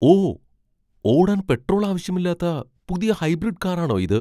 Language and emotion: Malayalam, surprised